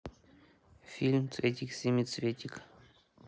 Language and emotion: Russian, neutral